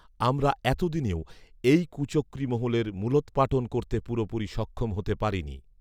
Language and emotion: Bengali, neutral